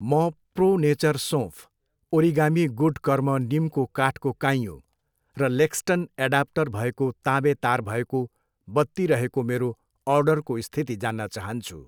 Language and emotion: Nepali, neutral